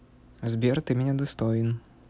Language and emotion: Russian, neutral